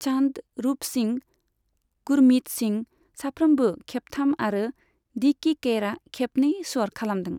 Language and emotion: Bodo, neutral